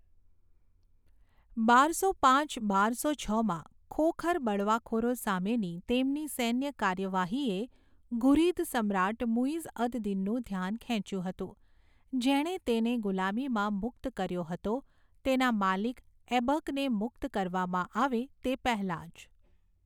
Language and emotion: Gujarati, neutral